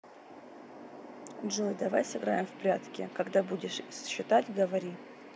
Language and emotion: Russian, neutral